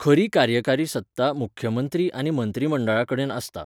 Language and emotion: Goan Konkani, neutral